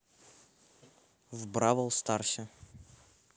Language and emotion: Russian, neutral